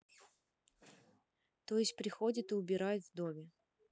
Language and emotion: Russian, neutral